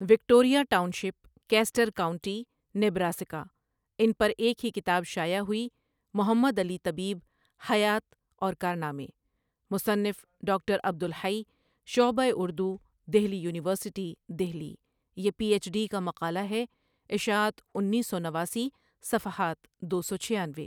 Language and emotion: Urdu, neutral